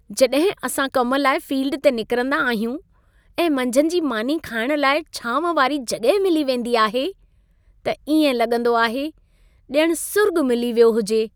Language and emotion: Sindhi, happy